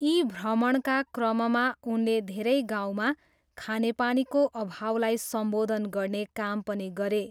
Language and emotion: Nepali, neutral